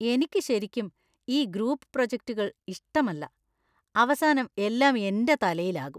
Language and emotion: Malayalam, disgusted